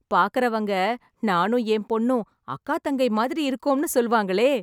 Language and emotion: Tamil, happy